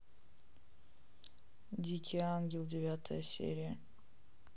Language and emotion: Russian, neutral